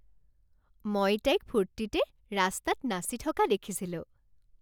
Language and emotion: Assamese, happy